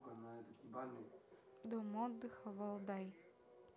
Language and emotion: Russian, neutral